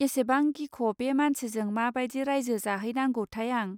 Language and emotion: Bodo, neutral